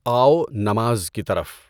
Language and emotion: Urdu, neutral